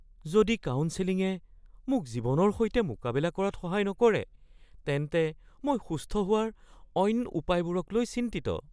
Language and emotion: Assamese, fearful